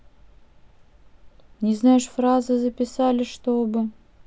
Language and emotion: Russian, neutral